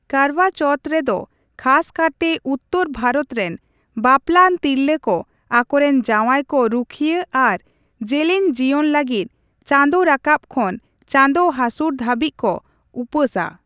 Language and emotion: Santali, neutral